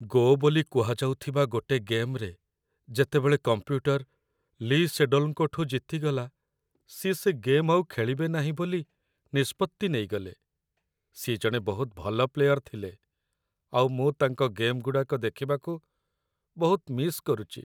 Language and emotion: Odia, sad